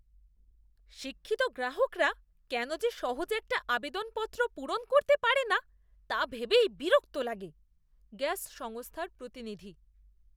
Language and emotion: Bengali, disgusted